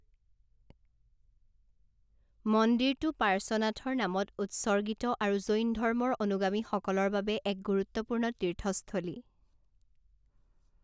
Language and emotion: Assamese, neutral